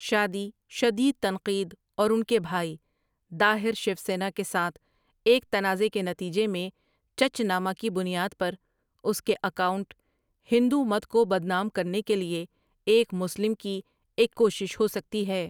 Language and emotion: Urdu, neutral